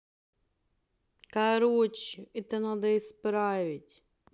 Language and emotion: Russian, angry